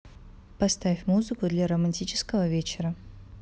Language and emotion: Russian, neutral